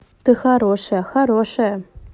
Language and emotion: Russian, positive